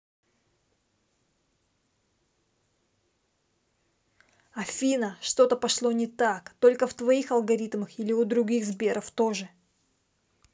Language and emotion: Russian, angry